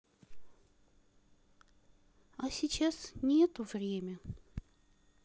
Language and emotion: Russian, sad